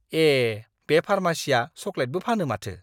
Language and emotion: Bodo, surprised